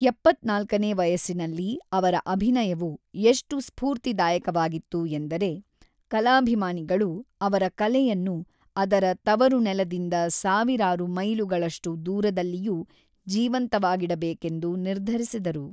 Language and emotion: Kannada, neutral